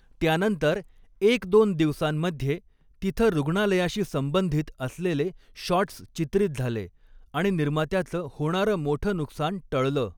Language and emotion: Marathi, neutral